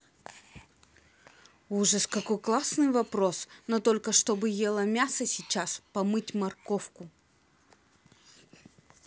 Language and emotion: Russian, angry